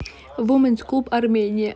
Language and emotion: Russian, neutral